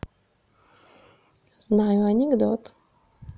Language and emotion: Russian, neutral